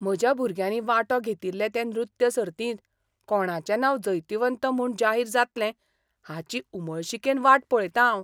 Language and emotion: Goan Konkani, surprised